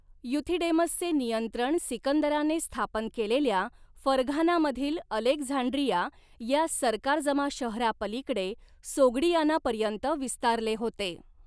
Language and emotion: Marathi, neutral